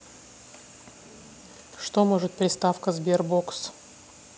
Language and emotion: Russian, neutral